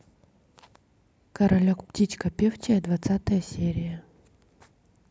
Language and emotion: Russian, neutral